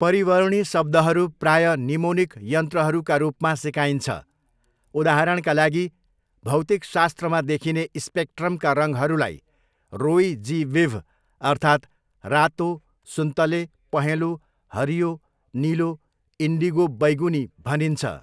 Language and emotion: Nepali, neutral